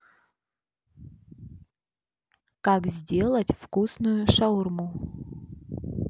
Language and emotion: Russian, neutral